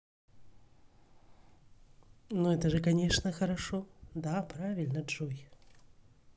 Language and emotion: Russian, positive